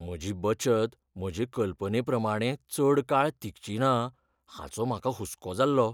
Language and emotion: Goan Konkani, fearful